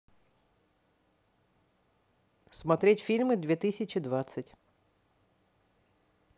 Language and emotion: Russian, neutral